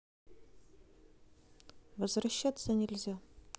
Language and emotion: Russian, neutral